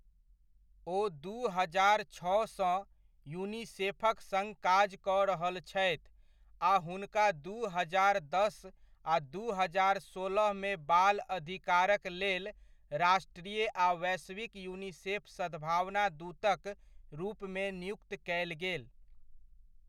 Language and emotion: Maithili, neutral